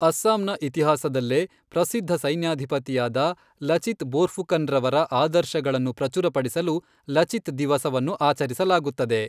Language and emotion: Kannada, neutral